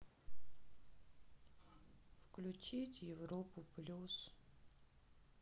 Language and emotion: Russian, sad